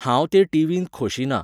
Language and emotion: Goan Konkani, neutral